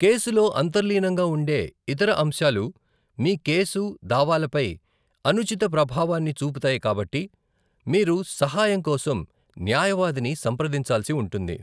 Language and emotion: Telugu, neutral